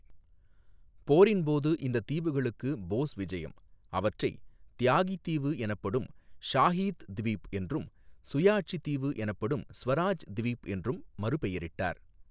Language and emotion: Tamil, neutral